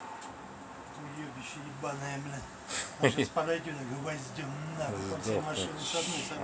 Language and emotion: Russian, angry